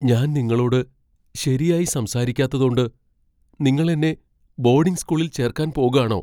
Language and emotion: Malayalam, fearful